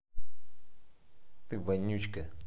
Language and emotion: Russian, neutral